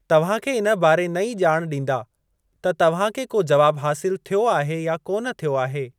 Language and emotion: Sindhi, neutral